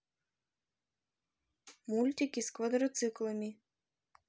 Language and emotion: Russian, neutral